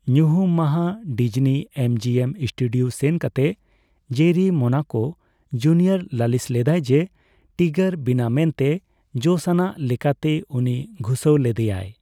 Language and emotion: Santali, neutral